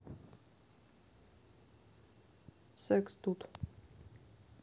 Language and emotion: Russian, neutral